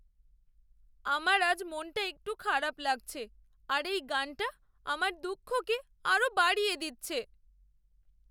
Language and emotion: Bengali, sad